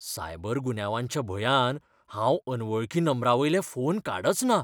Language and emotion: Goan Konkani, fearful